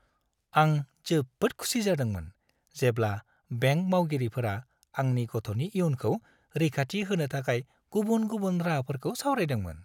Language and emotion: Bodo, happy